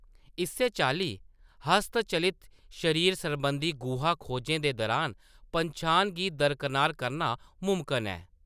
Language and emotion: Dogri, neutral